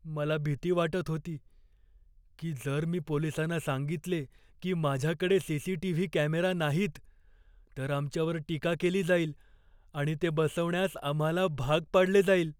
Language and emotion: Marathi, fearful